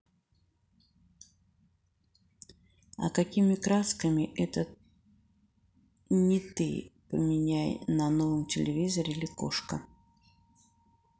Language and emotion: Russian, neutral